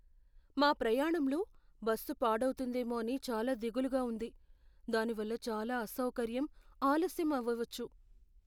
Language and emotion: Telugu, fearful